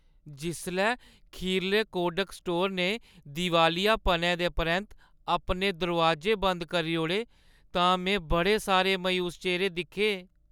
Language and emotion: Dogri, sad